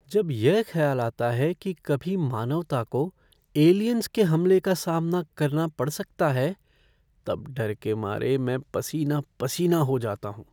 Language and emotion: Hindi, fearful